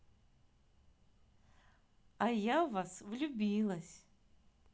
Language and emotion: Russian, positive